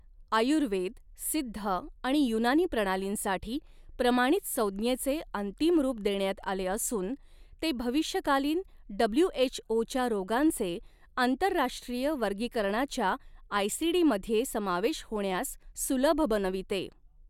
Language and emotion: Marathi, neutral